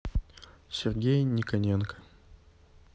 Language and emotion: Russian, neutral